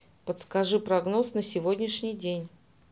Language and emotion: Russian, neutral